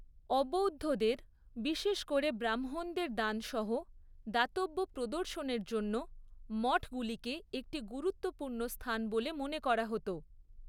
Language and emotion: Bengali, neutral